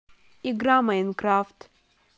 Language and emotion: Russian, neutral